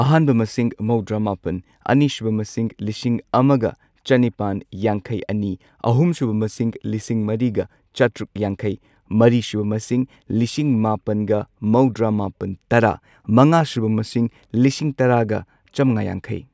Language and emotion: Manipuri, neutral